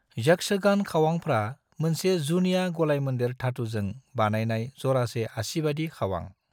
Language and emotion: Bodo, neutral